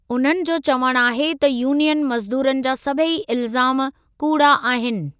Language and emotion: Sindhi, neutral